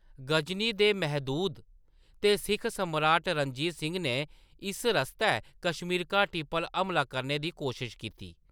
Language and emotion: Dogri, neutral